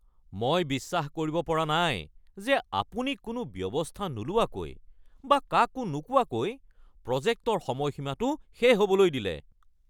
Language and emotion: Assamese, angry